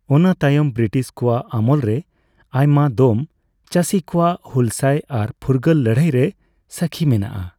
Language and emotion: Santali, neutral